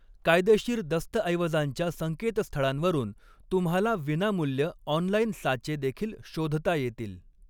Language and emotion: Marathi, neutral